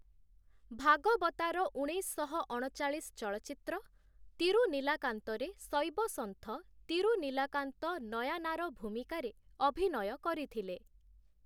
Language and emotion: Odia, neutral